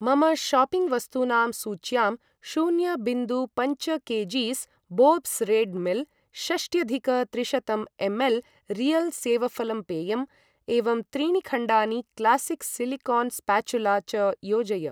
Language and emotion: Sanskrit, neutral